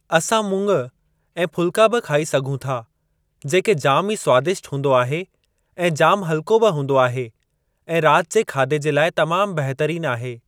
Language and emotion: Sindhi, neutral